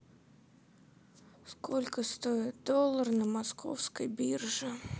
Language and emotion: Russian, sad